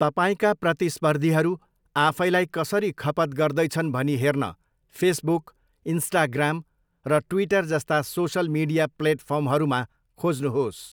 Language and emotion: Nepali, neutral